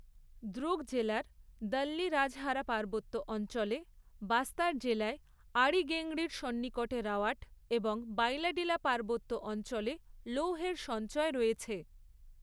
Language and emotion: Bengali, neutral